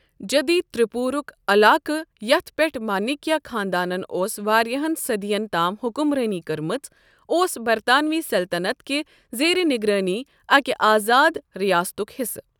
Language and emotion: Kashmiri, neutral